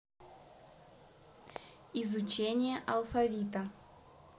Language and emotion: Russian, neutral